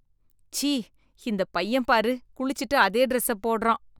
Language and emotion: Tamil, disgusted